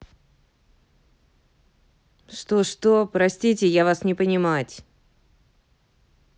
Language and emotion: Russian, angry